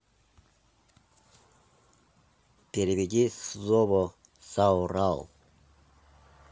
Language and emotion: Russian, neutral